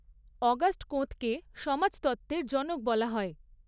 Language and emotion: Bengali, neutral